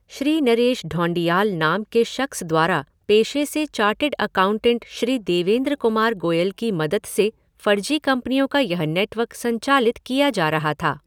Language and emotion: Hindi, neutral